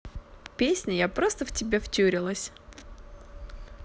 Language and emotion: Russian, positive